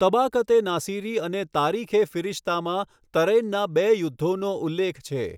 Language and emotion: Gujarati, neutral